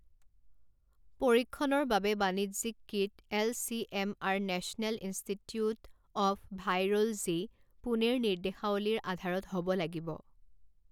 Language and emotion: Assamese, neutral